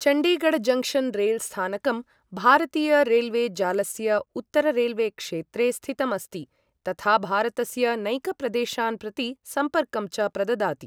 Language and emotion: Sanskrit, neutral